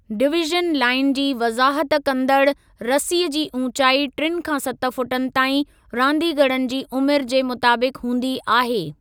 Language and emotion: Sindhi, neutral